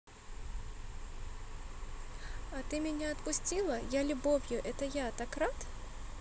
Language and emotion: Russian, neutral